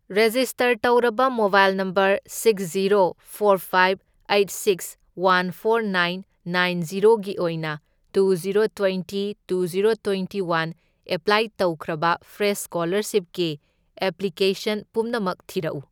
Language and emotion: Manipuri, neutral